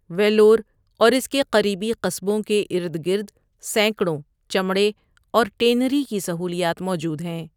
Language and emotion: Urdu, neutral